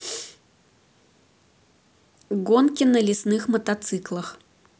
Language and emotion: Russian, neutral